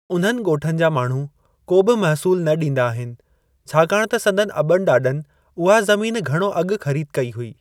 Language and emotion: Sindhi, neutral